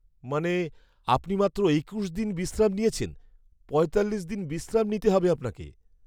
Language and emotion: Bengali, surprised